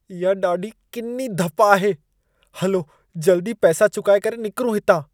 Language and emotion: Sindhi, disgusted